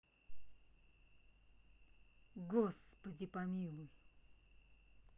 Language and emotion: Russian, angry